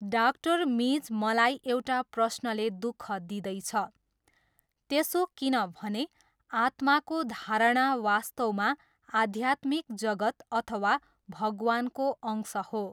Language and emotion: Nepali, neutral